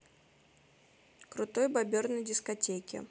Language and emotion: Russian, neutral